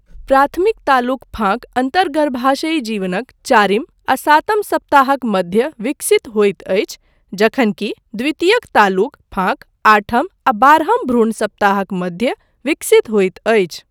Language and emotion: Maithili, neutral